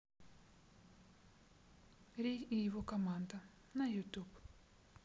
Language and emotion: Russian, neutral